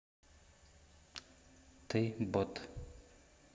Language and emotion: Russian, neutral